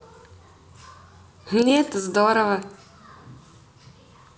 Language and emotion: Russian, positive